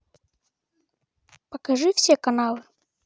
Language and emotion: Russian, neutral